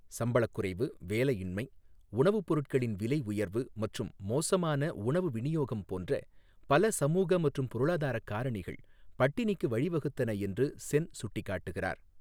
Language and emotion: Tamil, neutral